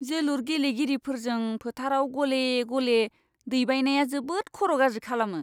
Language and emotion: Bodo, disgusted